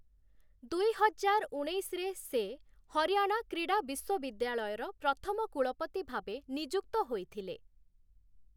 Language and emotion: Odia, neutral